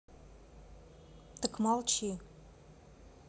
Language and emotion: Russian, neutral